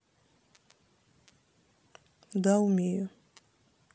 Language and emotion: Russian, neutral